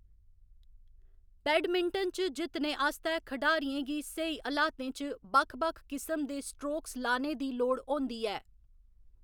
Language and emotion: Dogri, neutral